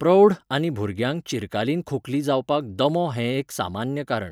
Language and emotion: Goan Konkani, neutral